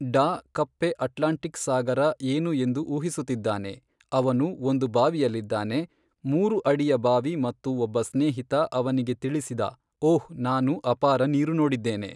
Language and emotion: Kannada, neutral